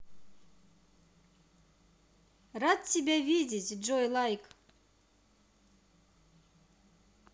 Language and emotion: Russian, positive